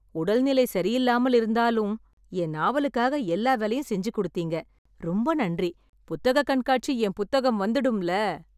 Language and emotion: Tamil, happy